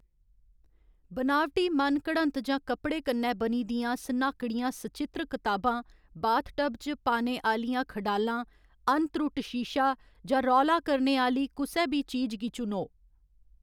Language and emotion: Dogri, neutral